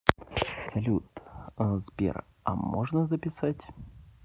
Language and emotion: Russian, neutral